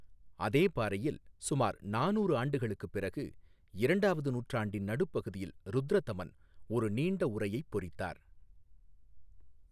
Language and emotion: Tamil, neutral